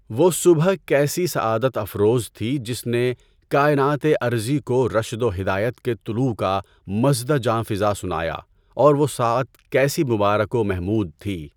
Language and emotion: Urdu, neutral